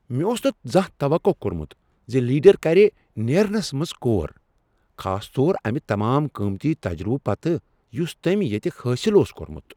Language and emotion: Kashmiri, surprised